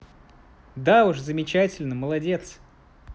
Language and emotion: Russian, positive